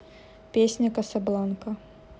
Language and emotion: Russian, neutral